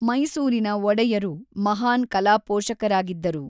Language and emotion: Kannada, neutral